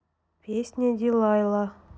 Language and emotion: Russian, neutral